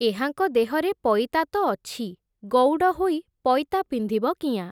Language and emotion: Odia, neutral